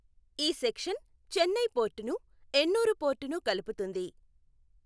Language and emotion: Telugu, neutral